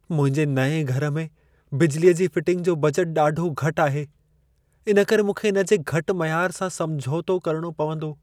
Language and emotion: Sindhi, sad